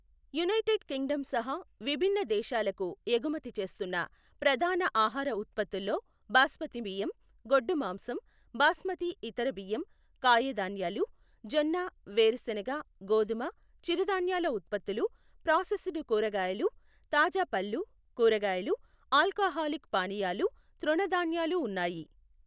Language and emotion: Telugu, neutral